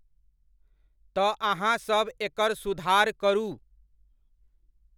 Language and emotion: Maithili, neutral